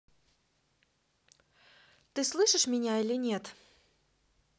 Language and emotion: Russian, neutral